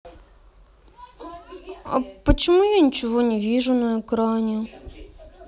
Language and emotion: Russian, sad